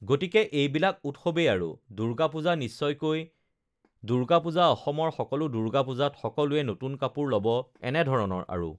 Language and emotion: Assamese, neutral